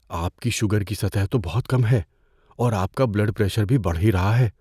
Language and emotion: Urdu, fearful